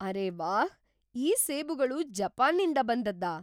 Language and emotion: Kannada, surprised